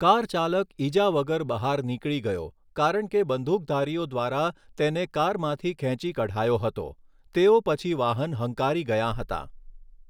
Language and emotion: Gujarati, neutral